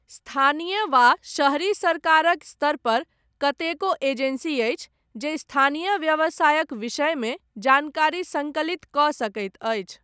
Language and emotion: Maithili, neutral